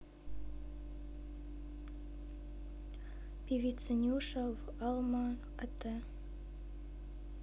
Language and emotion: Russian, neutral